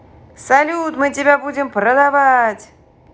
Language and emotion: Russian, positive